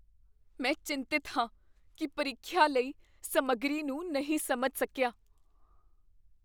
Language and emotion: Punjabi, fearful